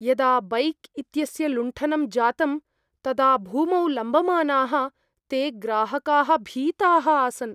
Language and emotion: Sanskrit, fearful